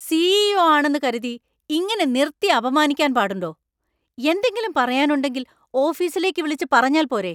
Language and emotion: Malayalam, angry